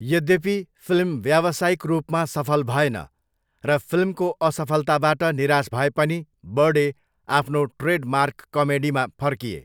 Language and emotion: Nepali, neutral